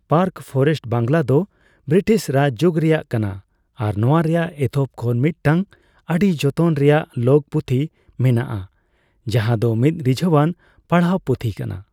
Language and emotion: Santali, neutral